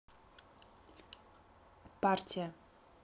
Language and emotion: Russian, neutral